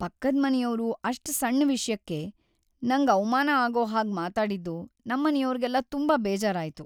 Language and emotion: Kannada, sad